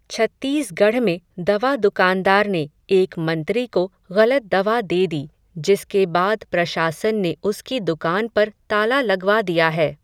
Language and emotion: Hindi, neutral